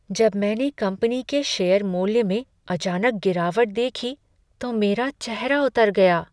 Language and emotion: Hindi, sad